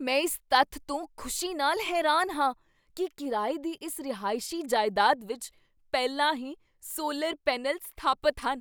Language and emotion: Punjabi, surprised